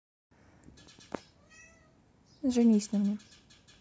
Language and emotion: Russian, neutral